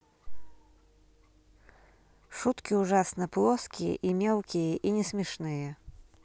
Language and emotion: Russian, neutral